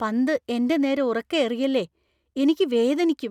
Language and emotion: Malayalam, fearful